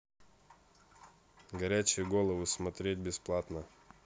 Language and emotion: Russian, neutral